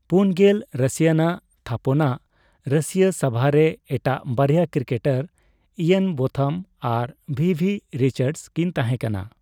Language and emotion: Santali, neutral